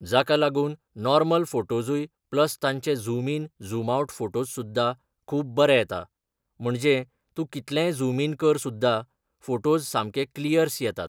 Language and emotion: Goan Konkani, neutral